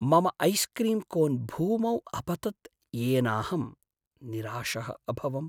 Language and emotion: Sanskrit, sad